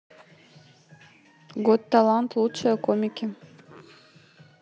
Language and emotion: Russian, neutral